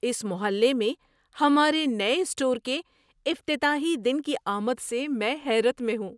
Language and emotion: Urdu, surprised